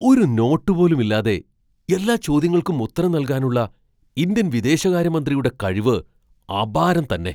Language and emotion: Malayalam, surprised